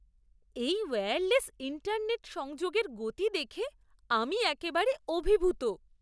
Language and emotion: Bengali, surprised